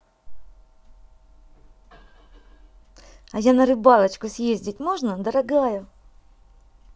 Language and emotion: Russian, positive